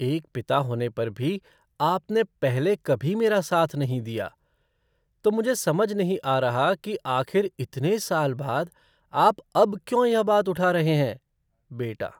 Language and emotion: Hindi, surprised